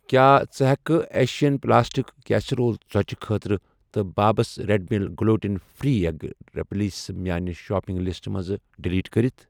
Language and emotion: Kashmiri, neutral